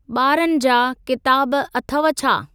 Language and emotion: Sindhi, neutral